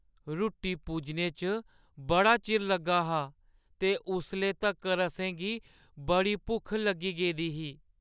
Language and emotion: Dogri, sad